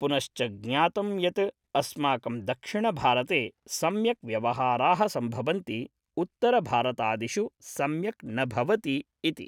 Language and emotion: Sanskrit, neutral